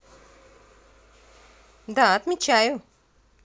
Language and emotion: Russian, positive